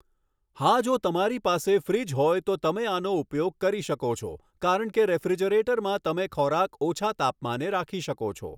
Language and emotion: Gujarati, neutral